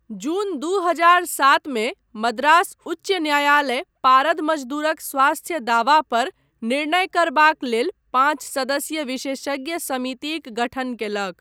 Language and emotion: Maithili, neutral